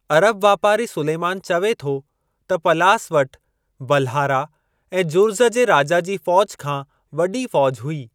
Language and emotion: Sindhi, neutral